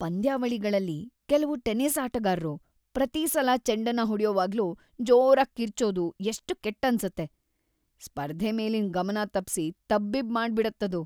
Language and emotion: Kannada, disgusted